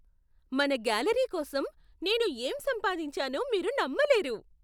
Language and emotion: Telugu, surprised